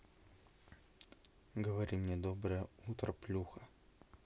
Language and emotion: Russian, neutral